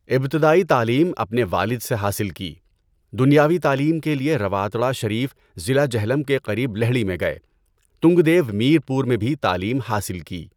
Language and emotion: Urdu, neutral